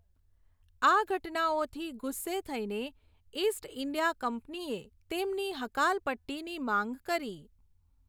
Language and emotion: Gujarati, neutral